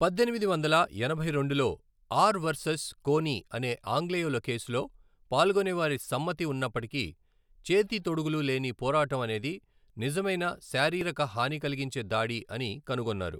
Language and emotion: Telugu, neutral